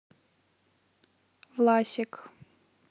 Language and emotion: Russian, neutral